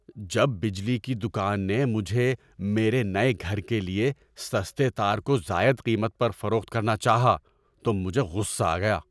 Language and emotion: Urdu, angry